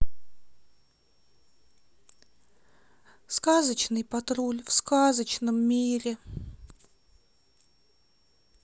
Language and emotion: Russian, sad